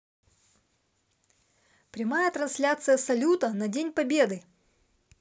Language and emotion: Russian, positive